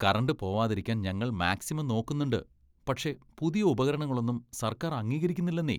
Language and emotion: Malayalam, disgusted